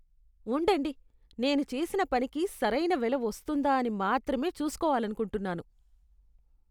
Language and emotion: Telugu, disgusted